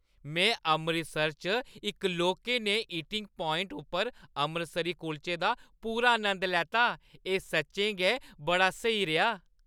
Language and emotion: Dogri, happy